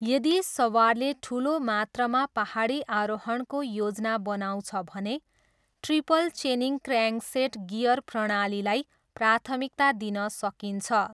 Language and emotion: Nepali, neutral